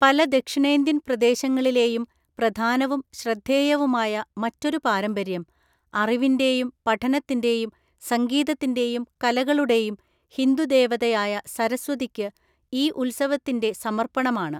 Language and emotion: Malayalam, neutral